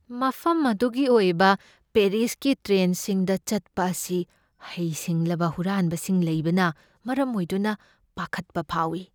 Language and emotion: Manipuri, fearful